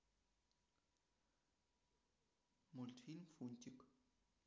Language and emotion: Russian, neutral